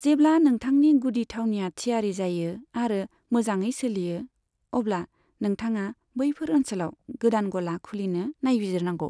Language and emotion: Bodo, neutral